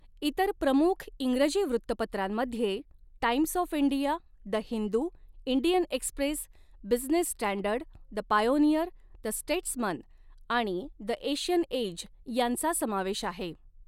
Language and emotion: Marathi, neutral